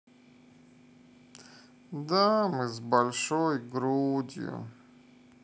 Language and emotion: Russian, sad